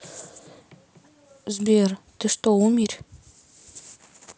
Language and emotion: Russian, neutral